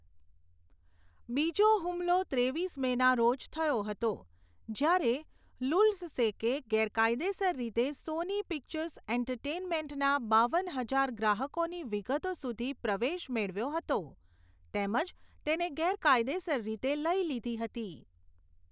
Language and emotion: Gujarati, neutral